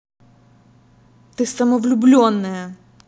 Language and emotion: Russian, angry